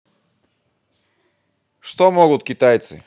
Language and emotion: Russian, positive